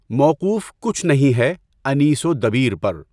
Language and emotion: Urdu, neutral